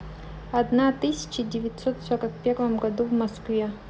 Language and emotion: Russian, neutral